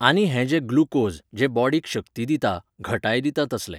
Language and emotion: Goan Konkani, neutral